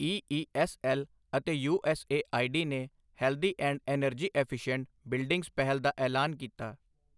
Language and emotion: Punjabi, neutral